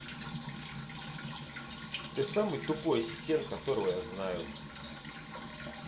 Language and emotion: Russian, angry